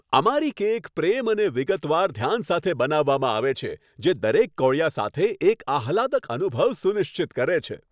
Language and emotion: Gujarati, happy